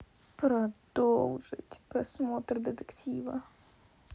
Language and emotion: Russian, sad